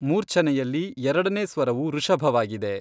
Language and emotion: Kannada, neutral